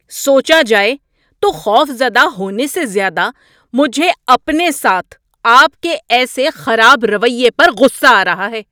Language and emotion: Urdu, angry